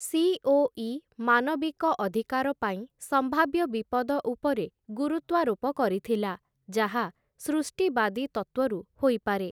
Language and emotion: Odia, neutral